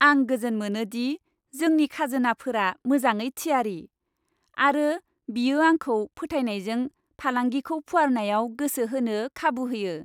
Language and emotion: Bodo, happy